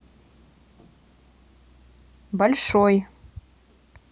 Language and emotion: Russian, neutral